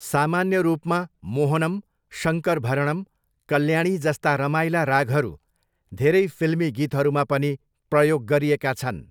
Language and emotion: Nepali, neutral